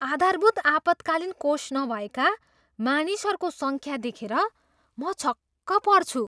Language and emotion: Nepali, surprised